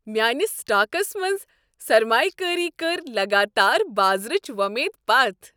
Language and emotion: Kashmiri, happy